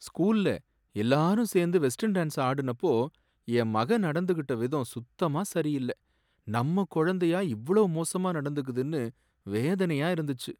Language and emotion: Tamil, sad